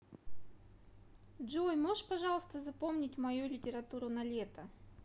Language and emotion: Russian, neutral